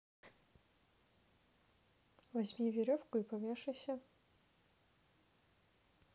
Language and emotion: Russian, neutral